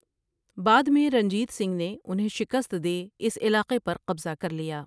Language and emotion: Urdu, neutral